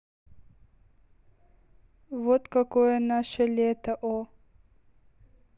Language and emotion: Russian, neutral